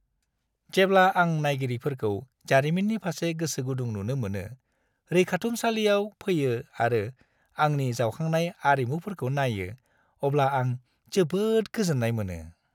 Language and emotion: Bodo, happy